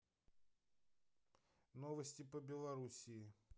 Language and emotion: Russian, neutral